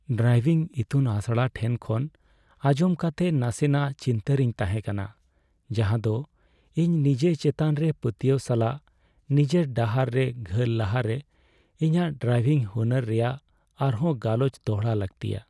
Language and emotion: Santali, sad